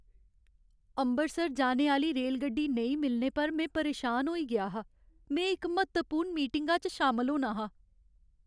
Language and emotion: Dogri, sad